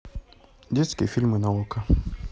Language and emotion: Russian, neutral